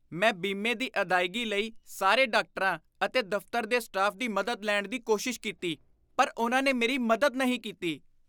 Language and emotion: Punjabi, disgusted